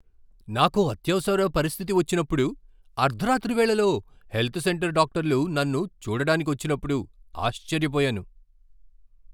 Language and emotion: Telugu, surprised